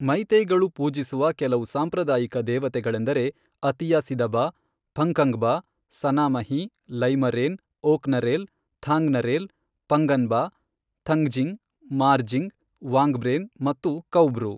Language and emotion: Kannada, neutral